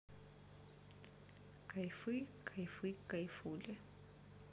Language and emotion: Russian, neutral